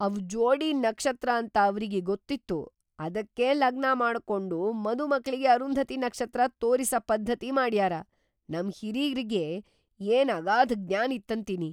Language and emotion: Kannada, surprised